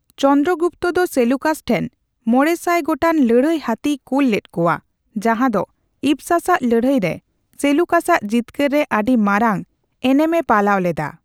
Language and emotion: Santali, neutral